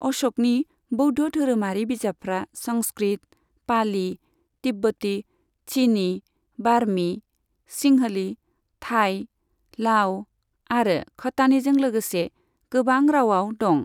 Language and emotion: Bodo, neutral